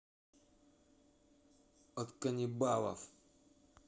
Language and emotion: Russian, angry